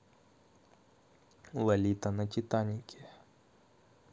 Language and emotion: Russian, neutral